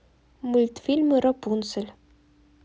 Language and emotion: Russian, neutral